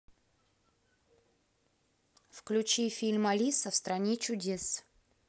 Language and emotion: Russian, neutral